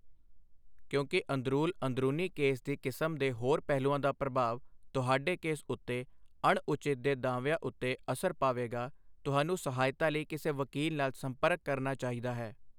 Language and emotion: Punjabi, neutral